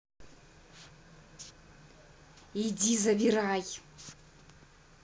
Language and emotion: Russian, angry